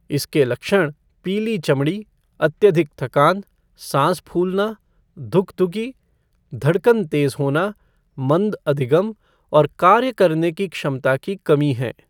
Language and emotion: Hindi, neutral